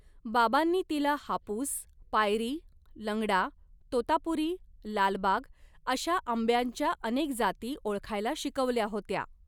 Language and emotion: Marathi, neutral